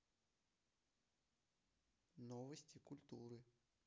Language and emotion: Russian, neutral